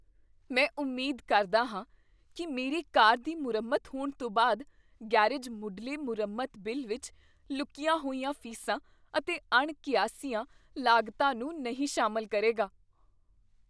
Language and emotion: Punjabi, fearful